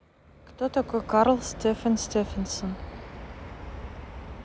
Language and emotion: Russian, neutral